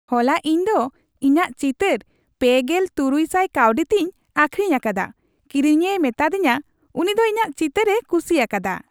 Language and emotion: Santali, happy